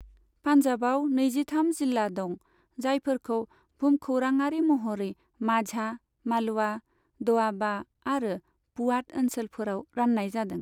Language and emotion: Bodo, neutral